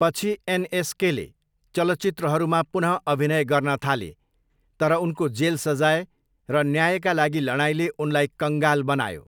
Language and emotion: Nepali, neutral